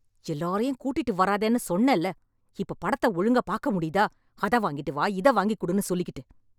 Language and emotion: Tamil, angry